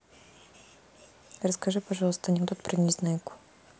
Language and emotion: Russian, neutral